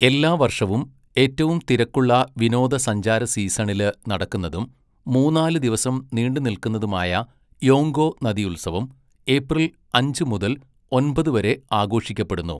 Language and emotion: Malayalam, neutral